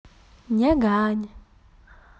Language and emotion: Russian, positive